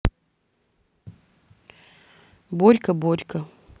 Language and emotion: Russian, neutral